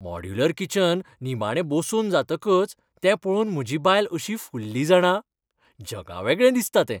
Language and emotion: Goan Konkani, happy